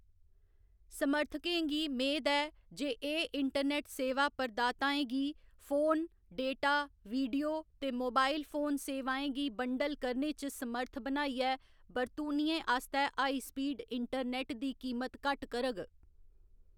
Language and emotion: Dogri, neutral